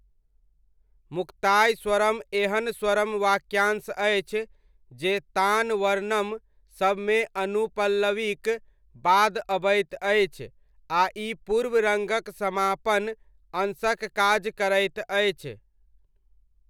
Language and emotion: Maithili, neutral